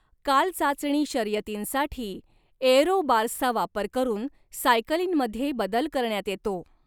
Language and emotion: Marathi, neutral